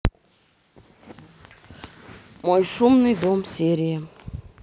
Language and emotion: Russian, neutral